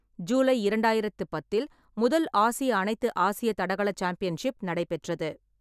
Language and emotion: Tamil, neutral